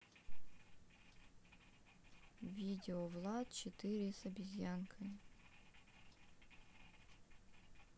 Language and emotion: Russian, neutral